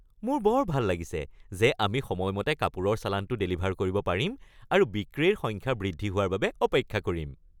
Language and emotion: Assamese, happy